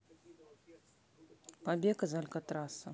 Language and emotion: Russian, neutral